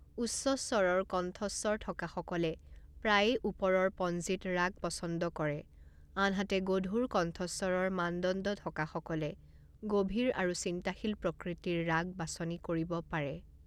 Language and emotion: Assamese, neutral